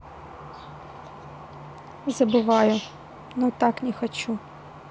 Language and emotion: Russian, neutral